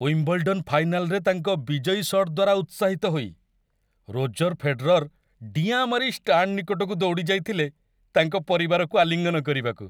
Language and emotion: Odia, happy